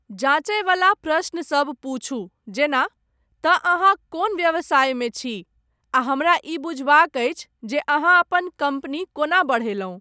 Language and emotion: Maithili, neutral